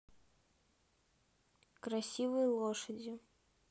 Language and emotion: Russian, neutral